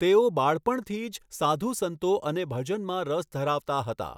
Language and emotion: Gujarati, neutral